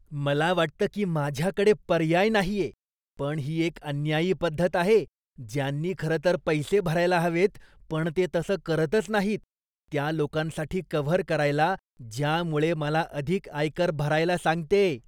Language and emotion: Marathi, disgusted